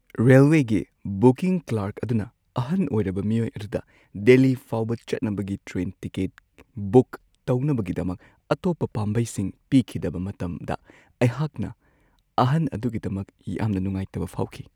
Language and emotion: Manipuri, sad